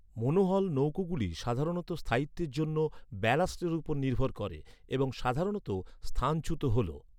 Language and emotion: Bengali, neutral